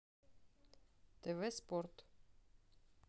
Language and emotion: Russian, neutral